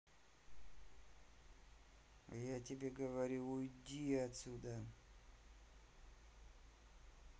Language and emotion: Russian, angry